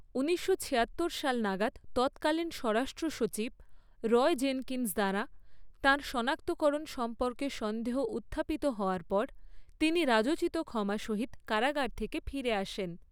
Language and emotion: Bengali, neutral